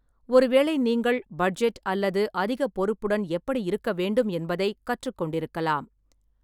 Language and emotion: Tamil, neutral